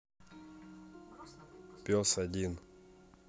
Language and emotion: Russian, neutral